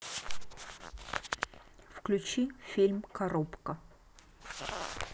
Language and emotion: Russian, neutral